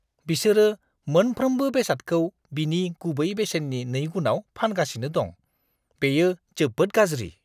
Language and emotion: Bodo, disgusted